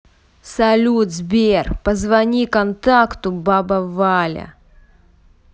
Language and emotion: Russian, angry